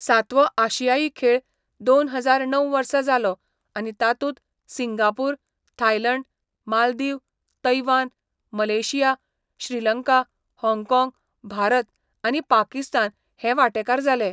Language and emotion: Goan Konkani, neutral